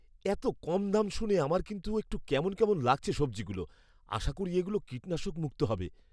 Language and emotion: Bengali, fearful